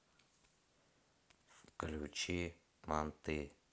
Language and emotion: Russian, neutral